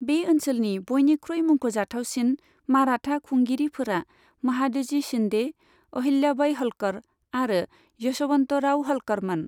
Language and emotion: Bodo, neutral